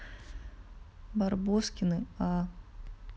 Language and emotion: Russian, neutral